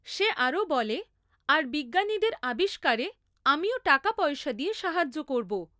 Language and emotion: Bengali, neutral